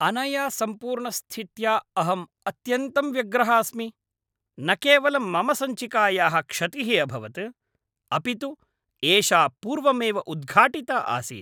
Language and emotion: Sanskrit, angry